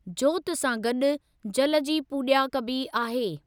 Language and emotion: Sindhi, neutral